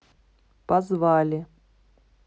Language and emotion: Russian, neutral